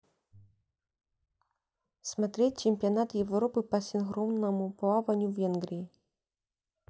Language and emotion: Russian, neutral